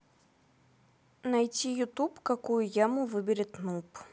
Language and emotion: Russian, neutral